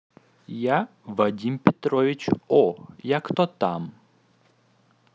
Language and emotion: Russian, positive